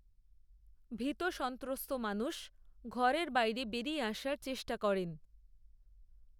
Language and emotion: Bengali, neutral